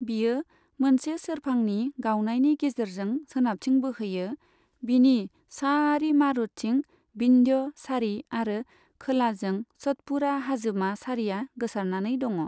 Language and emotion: Bodo, neutral